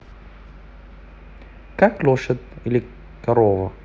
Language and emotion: Russian, neutral